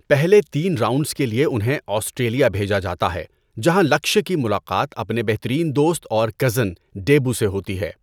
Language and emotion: Urdu, neutral